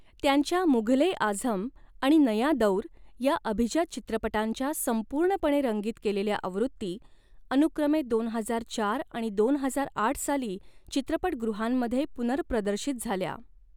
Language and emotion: Marathi, neutral